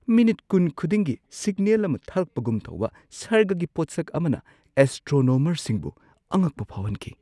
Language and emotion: Manipuri, surprised